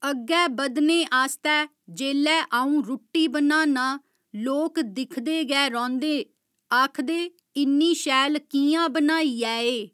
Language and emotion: Dogri, neutral